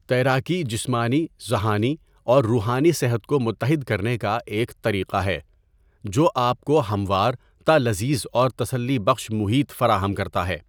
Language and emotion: Urdu, neutral